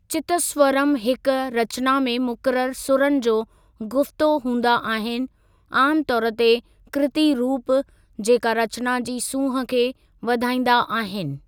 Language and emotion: Sindhi, neutral